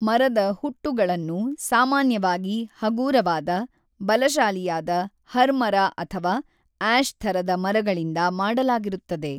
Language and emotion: Kannada, neutral